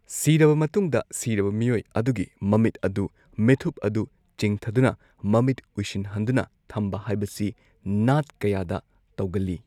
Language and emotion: Manipuri, neutral